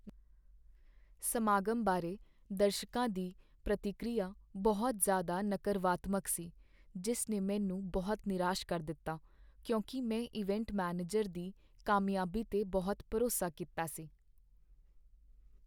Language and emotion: Punjabi, sad